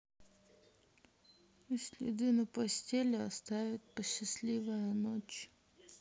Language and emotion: Russian, sad